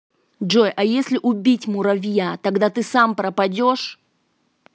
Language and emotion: Russian, angry